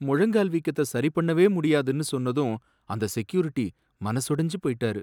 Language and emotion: Tamil, sad